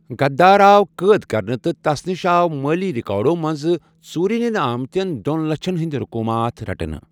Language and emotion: Kashmiri, neutral